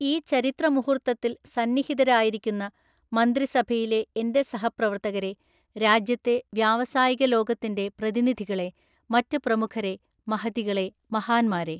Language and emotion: Malayalam, neutral